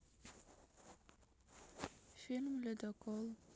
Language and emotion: Russian, sad